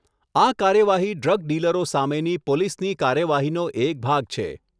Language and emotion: Gujarati, neutral